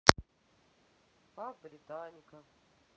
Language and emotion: Russian, sad